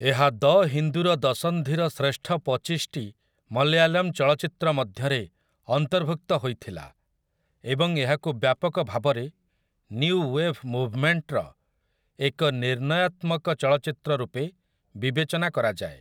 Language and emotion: Odia, neutral